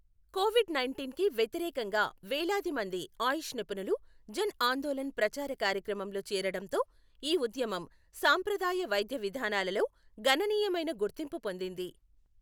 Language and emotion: Telugu, neutral